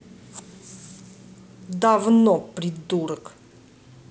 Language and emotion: Russian, angry